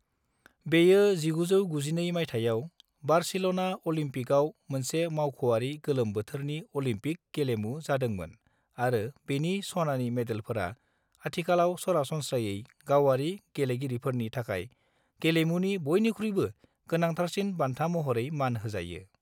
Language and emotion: Bodo, neutral